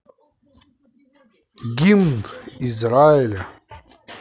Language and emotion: Russian, positive